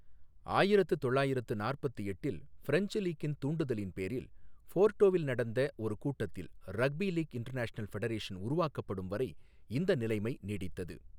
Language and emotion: Tamil, neutral